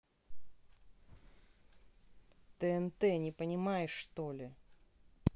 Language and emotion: Russian, angry